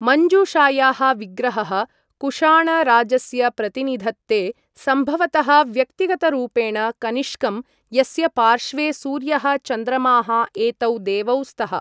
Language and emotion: Sanskrit, neutral